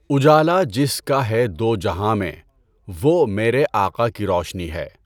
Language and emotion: Urdu, neutral